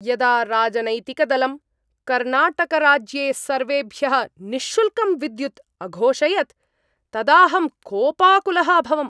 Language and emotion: Sanskrit, angry